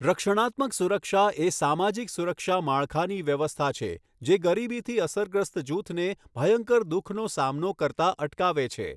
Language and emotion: Gujarati, neutral